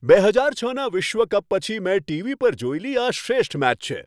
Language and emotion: Gujarati, happy